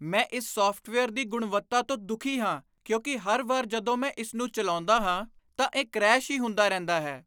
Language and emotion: Punjabi, disgusted